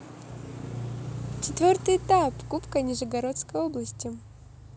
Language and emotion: Russian, positive